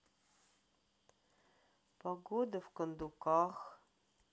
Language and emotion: Russian, sad